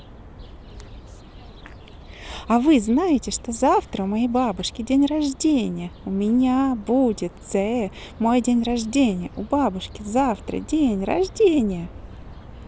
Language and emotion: Russian, positive